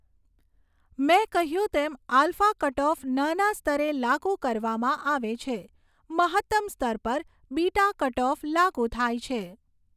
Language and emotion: Gujarati, neutral